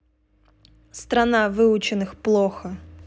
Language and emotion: Russian, neutral